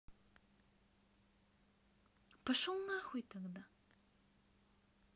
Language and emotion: Russian, neutral